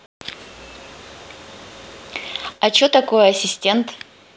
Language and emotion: Russian, positive